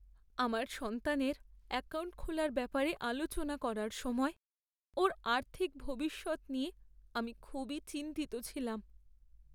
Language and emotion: Bengali, sad